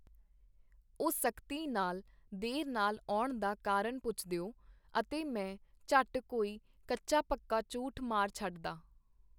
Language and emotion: Punjabi, neutral